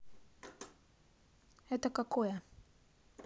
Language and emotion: Russian, neutral